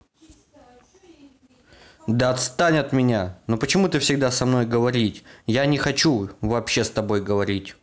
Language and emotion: Russian, angry